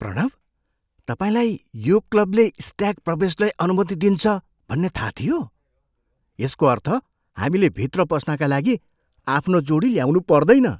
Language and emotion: Nepali, surprised